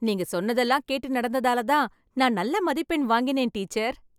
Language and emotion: Tamil, happy